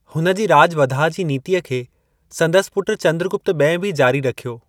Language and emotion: Sindhi, neutral